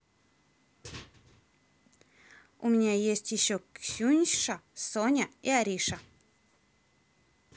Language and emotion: Russian, neutral